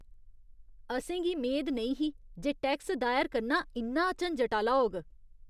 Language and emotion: Dogri, disgusted